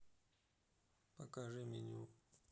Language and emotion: Russian, neutral